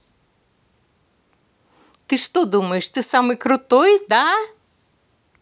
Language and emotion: Russian, angry